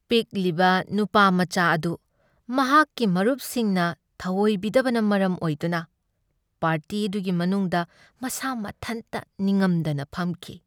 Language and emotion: Manipuri, sad